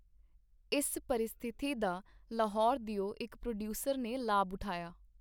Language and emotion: Punjabi, neutral